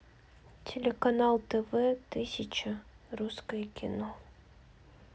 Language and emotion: Russian, sad